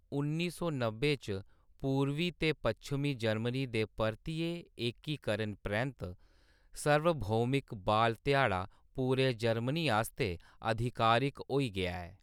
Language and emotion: Dogri, neutral